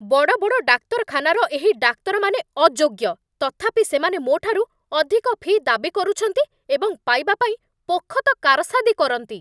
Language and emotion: Odia, angry